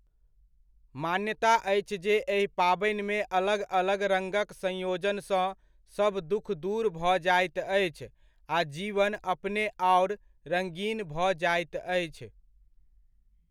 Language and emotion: Maithili, neutral